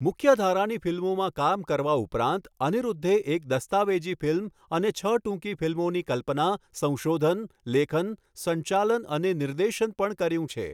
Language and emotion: Gujarati, neutral